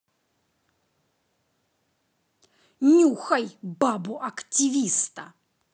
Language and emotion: Russian, angry